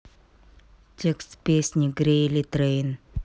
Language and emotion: Russian, neutral